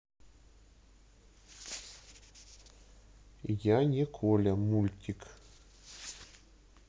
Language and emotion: Russian, neutral